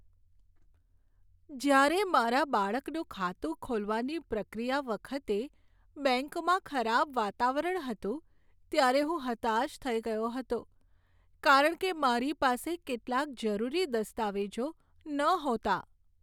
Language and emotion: Gujarati, sad